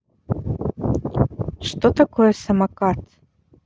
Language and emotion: Russian, neutral